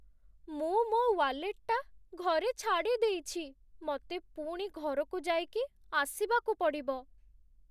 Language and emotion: Odia, sad